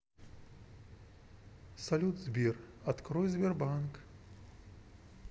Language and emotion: Russian, neutral